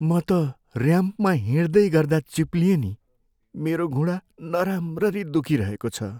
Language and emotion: Nepali, sad